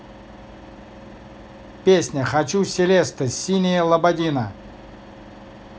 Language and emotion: Russian, positive